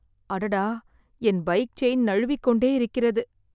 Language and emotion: Tamil, sad